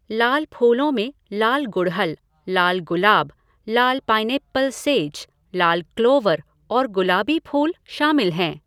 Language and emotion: Hindi, neutral